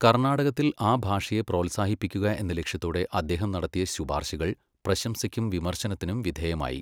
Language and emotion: Malayalam, neutral